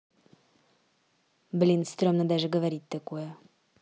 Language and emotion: Russian, neutral